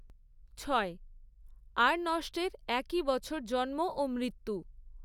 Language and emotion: Bengali, neutral